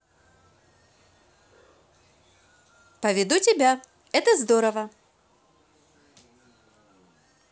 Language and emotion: Russian, positive